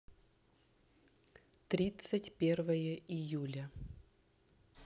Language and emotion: Russian, neutral